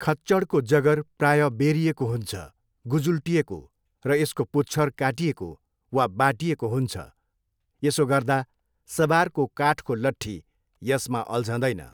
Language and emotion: Nepali, neutral